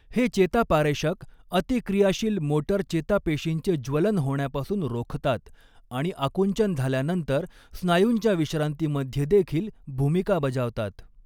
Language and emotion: Marathi, neutral